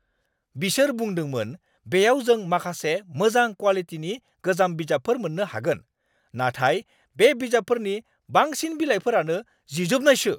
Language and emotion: Bodo, angry